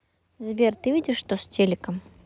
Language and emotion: Russian, neutral